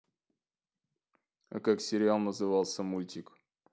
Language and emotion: Russian, neutral